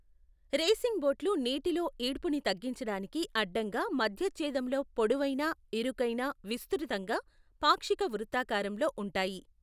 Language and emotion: Telugu, neutral